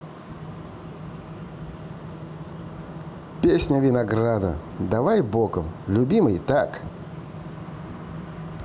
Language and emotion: Russian, positive